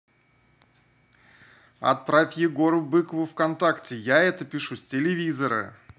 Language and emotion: Russian, angry